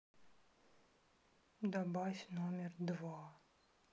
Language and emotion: Russian, sad